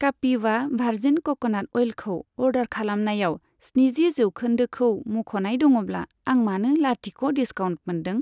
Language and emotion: Bodo, neutral